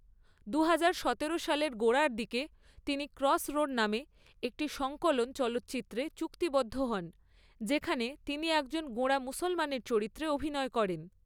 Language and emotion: Bengali, neutral